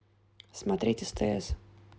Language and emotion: Russian, neutral